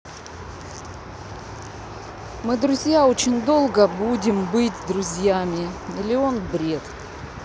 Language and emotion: Russian, neutral